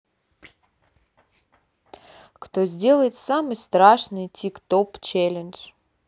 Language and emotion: Russian, neutral